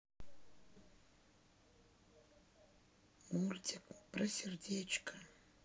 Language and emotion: Russian, sad